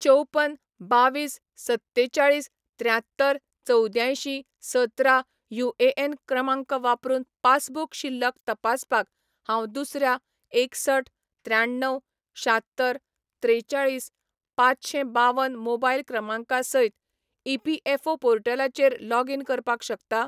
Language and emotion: Goan Konkani, neutral